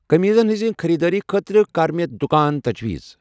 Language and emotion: Kashmiri, neutral